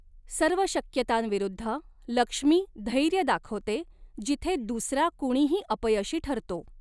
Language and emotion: Marathi, neutral